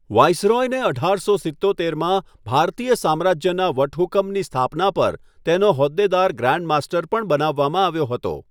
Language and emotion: Gujarati, neutral